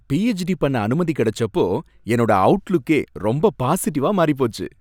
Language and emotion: Tamil, happy